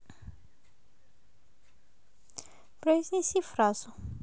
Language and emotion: Russian, neutral